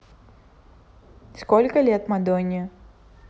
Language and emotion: Russian, neutral